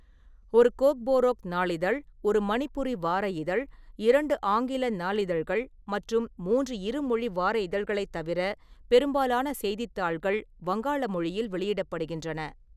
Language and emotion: Tamil, neutral